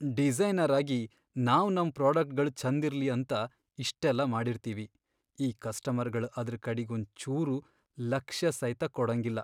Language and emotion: Kannada, sad